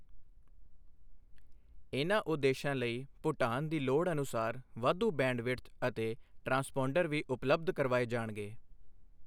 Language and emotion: Punjabi, neutral